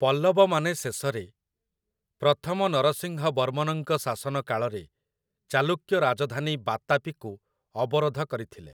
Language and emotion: Odia, neutral